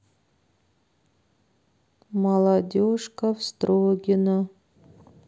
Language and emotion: Russian, neutral